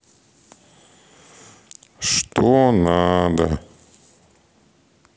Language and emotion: Russian, sad